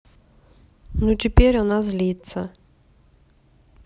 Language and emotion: Russian, neutral